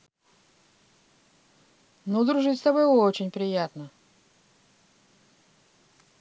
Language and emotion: Russian, positive